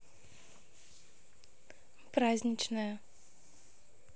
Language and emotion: Russian, neutral